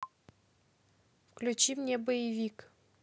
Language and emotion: Russian, neutral